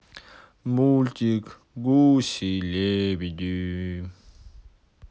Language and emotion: Russian, sad